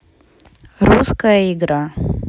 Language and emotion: Russian, neutral